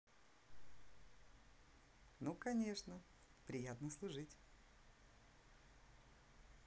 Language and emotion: Russian, positive